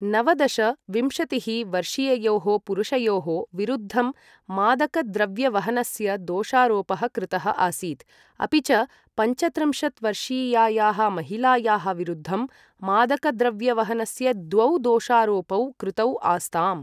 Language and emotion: Sanskrit, neutral